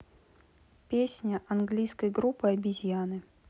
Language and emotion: Russian, neutral